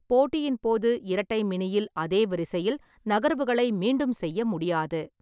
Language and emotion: Tamil, neutral